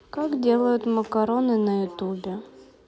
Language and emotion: Russian, sad